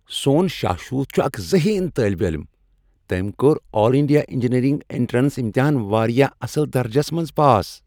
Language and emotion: Kashmiri, happy